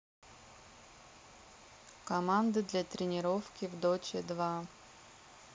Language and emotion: Russian, neutral